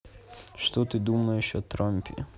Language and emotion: Russian, neutral